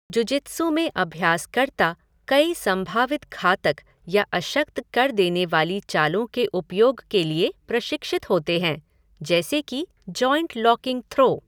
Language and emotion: Hindi, neutral